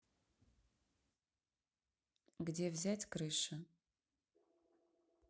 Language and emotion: Russian, neutral